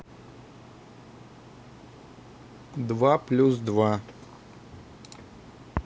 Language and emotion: Russian, neutral